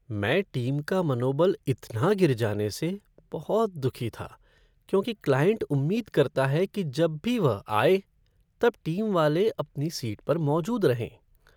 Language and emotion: Hindi, sad